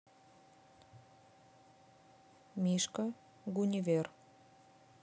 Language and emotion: Russian, neutral